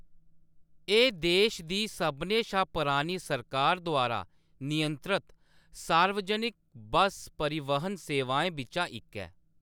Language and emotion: Dogri, neutral